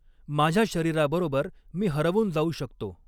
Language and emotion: Marathi, neutral